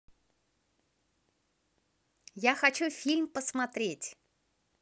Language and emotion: Russian, positive